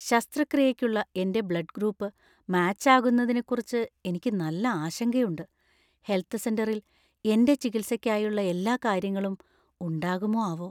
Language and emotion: Malayalam, fearful